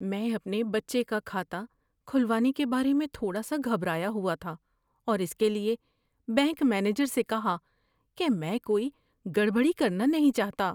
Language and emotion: Urdu, fearful